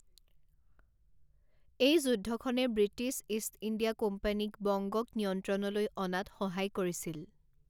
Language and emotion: Assamese, neutral